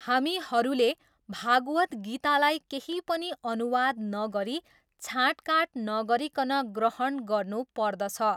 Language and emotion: Nepali, neutral